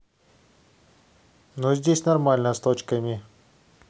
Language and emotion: Russian, neutral